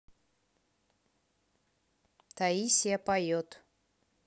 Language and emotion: Russian, neutral